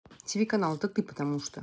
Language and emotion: Russian, angry